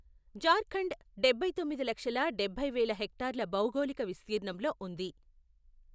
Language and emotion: Telugu, neutral